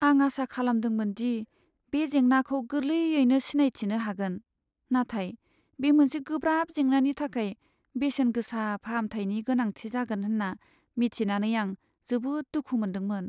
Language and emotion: Bodo, sad